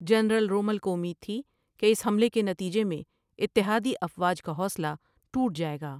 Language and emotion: Urdu, neutral